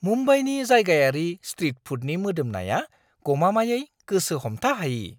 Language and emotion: Bodo, surprised